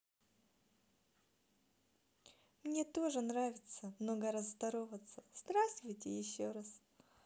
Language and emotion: Russian, positive